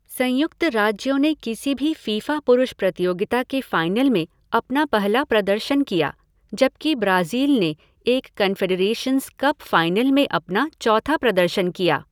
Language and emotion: Hindi, neutral